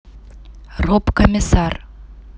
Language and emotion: Russian, neutral